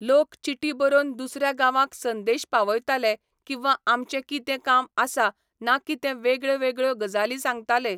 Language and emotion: Goan Konkani, neutral